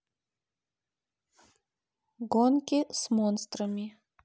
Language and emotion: Russian, neutral